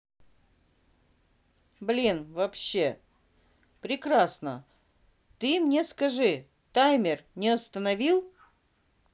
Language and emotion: Russian, neutral